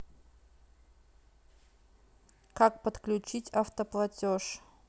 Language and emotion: Russian, neutral